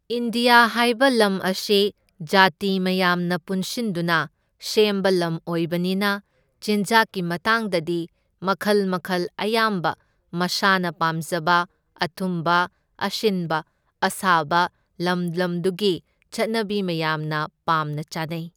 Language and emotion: Manipuri, neutral